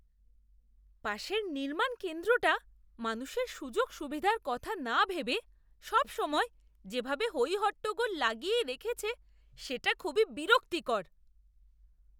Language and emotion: Bengali, disgusted